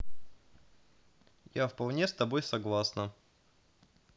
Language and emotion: Russian, positive